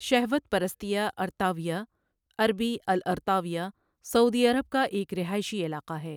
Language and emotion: Urdu, neutral